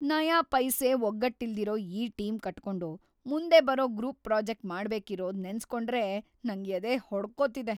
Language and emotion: Kannada, fearful